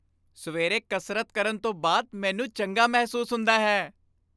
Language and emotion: Punjabi, happy